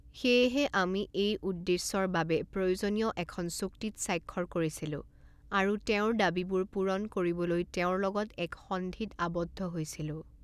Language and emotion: Assamese, neutral